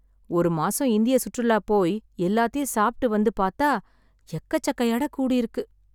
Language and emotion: Tamil, sad